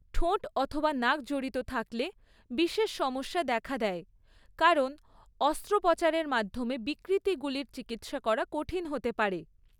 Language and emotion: Bengali, neutral